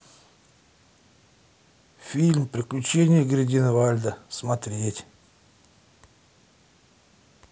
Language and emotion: Russian, sad